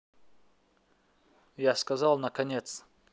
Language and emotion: Russian, neutral